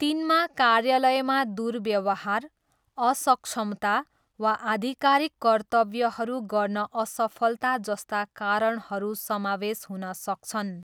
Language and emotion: Nepali, neutral